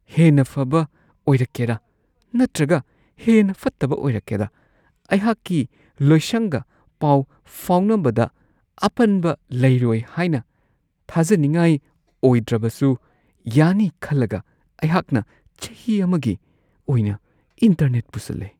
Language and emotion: Manipuri, fearful